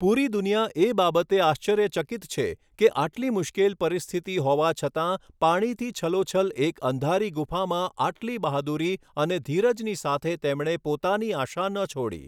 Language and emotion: Gujarati, neutral